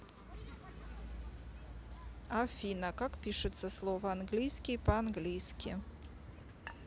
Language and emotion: Russian, neutral